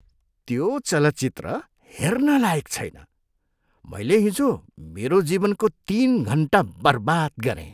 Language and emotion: Nepali, disgusted